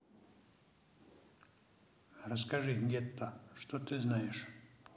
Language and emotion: Russian, neutral